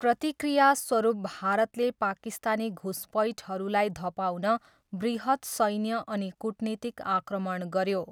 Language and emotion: Nepali, neutral